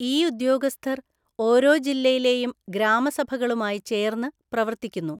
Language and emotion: Malayalam, neutral